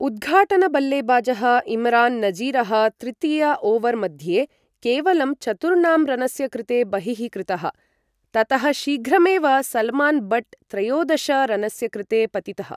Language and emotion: Sanskrit, neutral